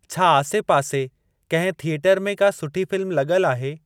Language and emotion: Sindhi, neutral